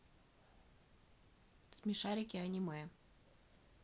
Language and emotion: Russian, neutral